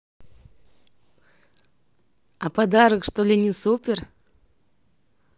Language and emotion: Russian, positive